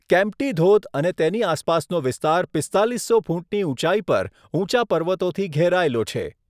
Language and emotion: Gujarati, neutral